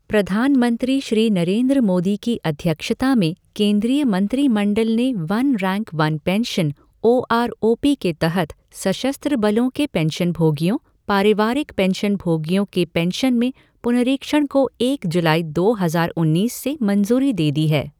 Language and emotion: Hindi, neutral